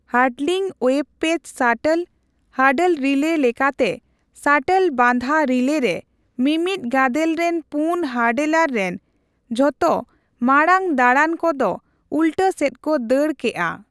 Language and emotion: Santali, neutral